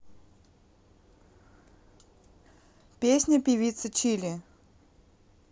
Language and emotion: Russian, neutral